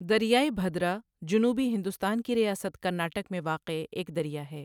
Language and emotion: Urdu, neutral